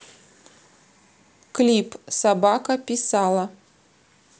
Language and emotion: Russian, neutral